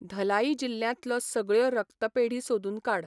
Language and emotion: Goan Konkani, neutral